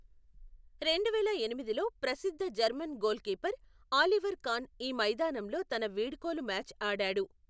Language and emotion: Telugu, neutral